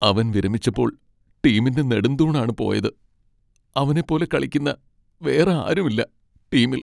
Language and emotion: Malayalam, sad